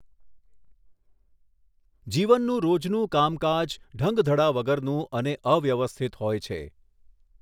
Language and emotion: Gujarati, neutral